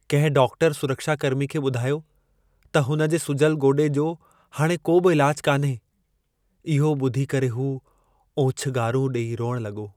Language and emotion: Sindhi, sad